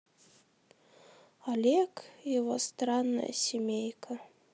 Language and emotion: Russian, sad